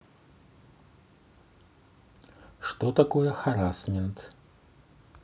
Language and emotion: Russian, neutral